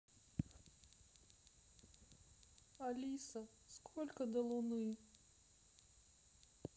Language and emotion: Russian, sad